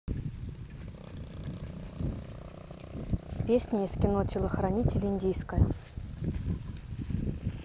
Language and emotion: Russian, neutral